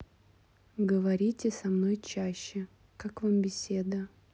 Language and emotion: Russian, neutral